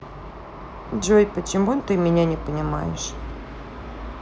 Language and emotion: Russian, sad